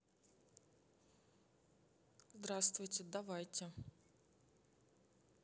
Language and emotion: Russian, neutral